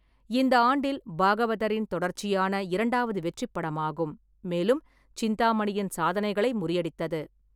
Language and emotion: Tamil, neutral